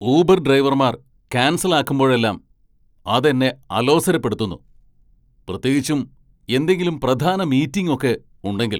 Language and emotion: Malayalam, angry